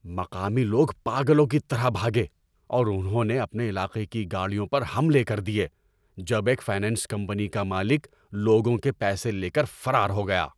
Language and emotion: Urdu, angry